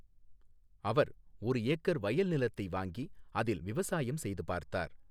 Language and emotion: Tamil, neutral